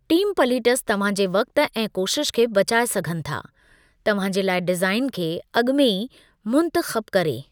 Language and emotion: Sindhi, neutral